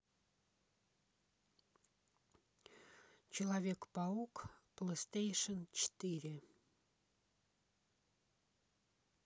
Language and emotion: Russian, neutral